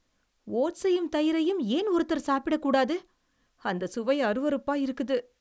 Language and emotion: Tamil, disgusted